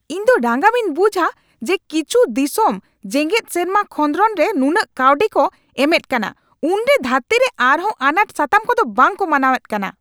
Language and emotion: Santali, angry